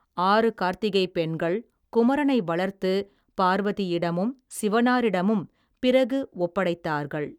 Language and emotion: Tamil, neutral